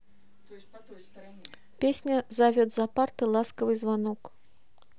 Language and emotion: Russian, neutral